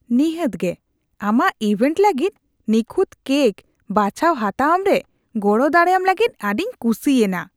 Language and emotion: Santali, disgusted